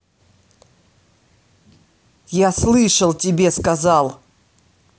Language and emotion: Russian, angry